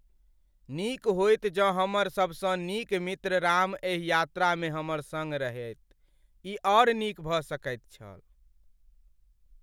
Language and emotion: Maithili, sad